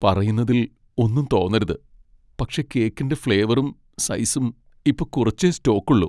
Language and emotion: Malayalam, sad